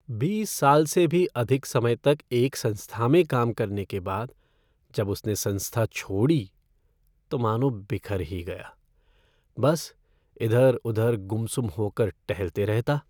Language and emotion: Hindi, sad